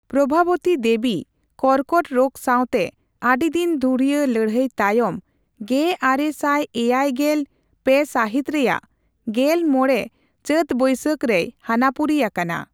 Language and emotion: Santali, neutral